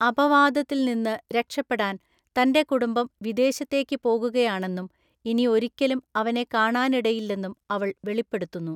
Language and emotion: Malayalam, neutral